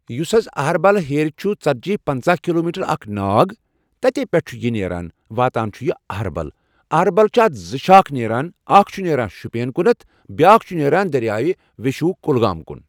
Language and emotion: Kashmiri, neutral